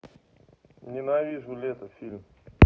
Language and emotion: Russian, neutral